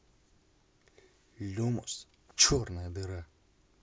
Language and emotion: Russian, neutral